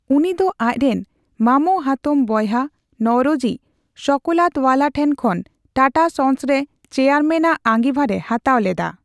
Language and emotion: Santali, neutral